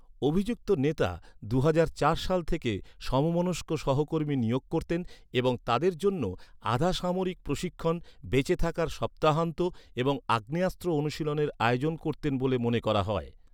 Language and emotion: Bengali, neutral